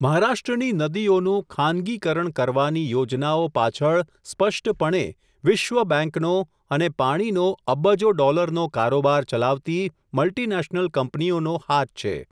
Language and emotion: Gujarati, neutral